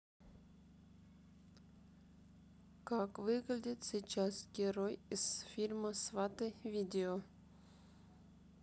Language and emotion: Russian, neutral